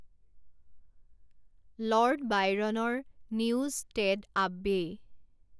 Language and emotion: Assamese, neutral